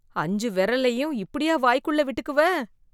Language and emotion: Tamil, disgusted